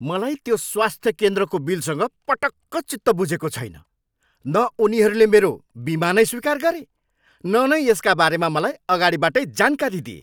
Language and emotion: Nepali, angry